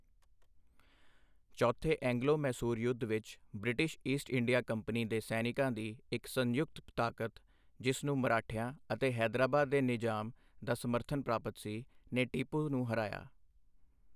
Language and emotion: Punjabi, neutral